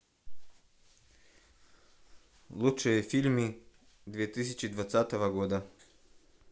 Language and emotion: Russian, neutral